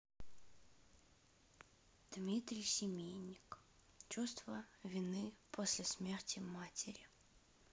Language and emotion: Russian, sad